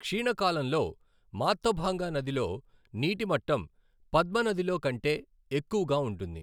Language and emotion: Telugu, neutral